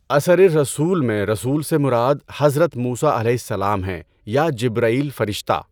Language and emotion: Urdu, neutral